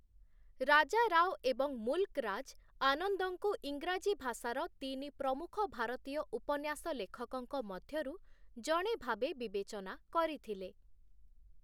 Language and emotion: Odia, neutral